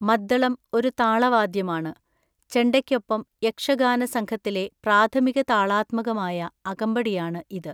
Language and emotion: Malayalam, neutral